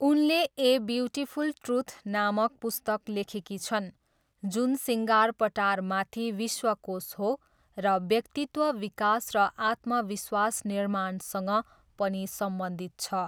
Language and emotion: Nepali, neutral